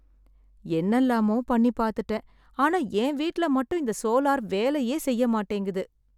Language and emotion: Tamil, sad